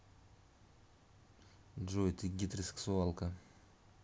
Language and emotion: Russian, neutral